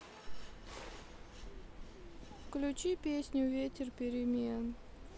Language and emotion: Russian, sad